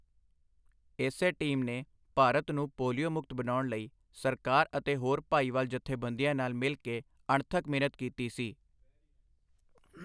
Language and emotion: Punjabi, neutral